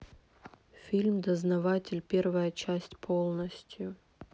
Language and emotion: Russian, sad